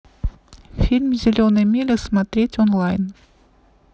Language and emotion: Russian, neutral